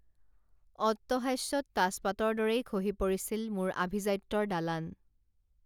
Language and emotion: Assamese, neutral